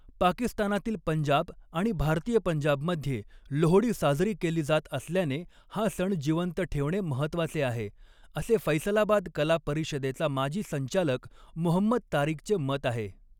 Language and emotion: Marathi, neutral